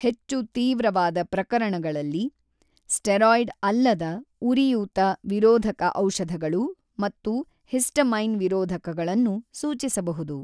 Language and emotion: Kannada, neutral